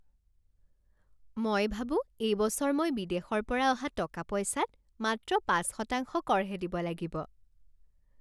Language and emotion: Assamese, happy